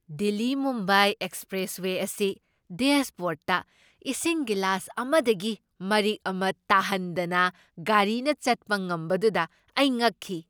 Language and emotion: Manipuri, surprised